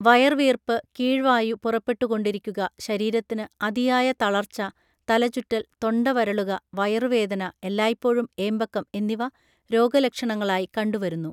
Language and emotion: Malayalam, neutral